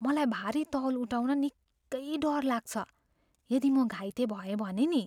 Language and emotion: Nepali, fearful